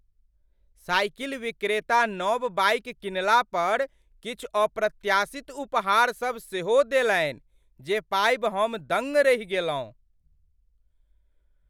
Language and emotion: Maithili, surprised